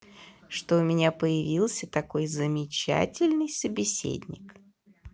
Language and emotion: Russian, positive